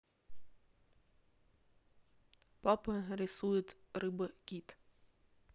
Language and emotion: Russian, neutral